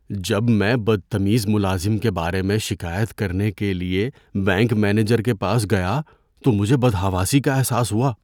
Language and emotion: Urdu, fearful